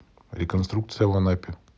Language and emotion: Russian, neutral